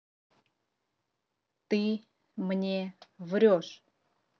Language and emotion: Russian, neutral